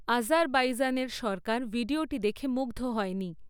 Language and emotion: Bengali, neutral